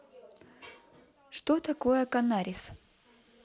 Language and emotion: Russian, neutral